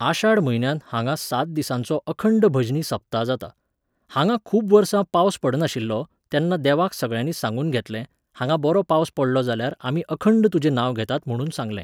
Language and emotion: Goan Konkani, neutral